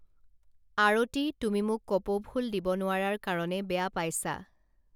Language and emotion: Assamese, neutral